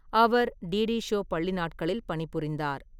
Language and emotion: Tamil, neutral